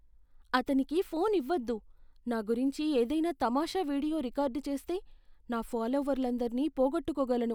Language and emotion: Telugu, fearful